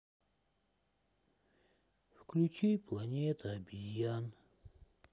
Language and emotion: Russian, sad